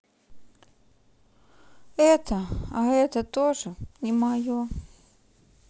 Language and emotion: Russian, sad